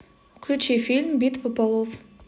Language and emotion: Russian, neutral